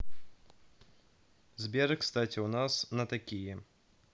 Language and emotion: Russian, neutral